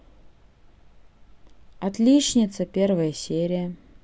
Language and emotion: Russian, neutral